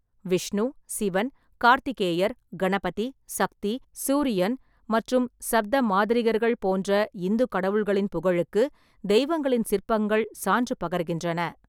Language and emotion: Tamil, neutral